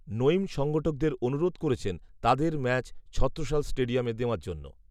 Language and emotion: Bengali, neutral